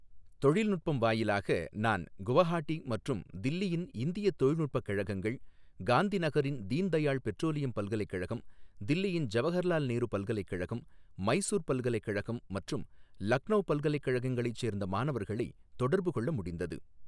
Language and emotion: Tamil, neutral